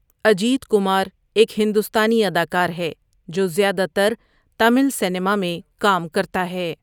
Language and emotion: Urdu, neutral